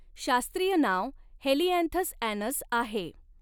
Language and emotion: Marathi, neutral